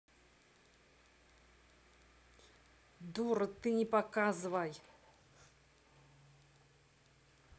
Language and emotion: Russian, angry